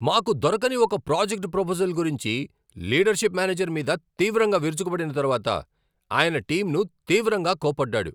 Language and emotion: Telugu, angry